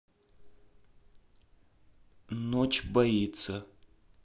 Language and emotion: Russian, neutral